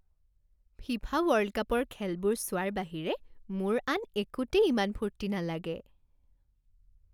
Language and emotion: Assamese, happy